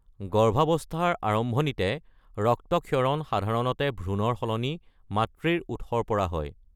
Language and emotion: Assamese, neutral